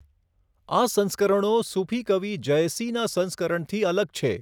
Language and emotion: Gujarati, neutral